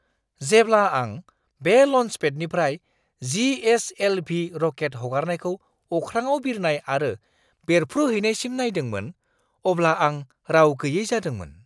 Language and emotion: Bodo, surprised